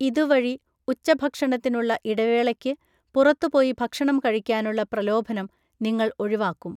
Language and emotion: Malayalam, neutral